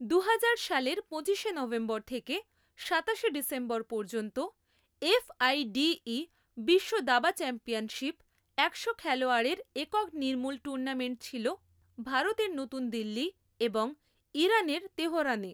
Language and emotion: Bengali, neutral